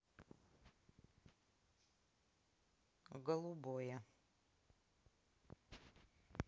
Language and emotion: Russian, neutral